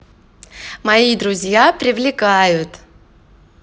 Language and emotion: Russian, positive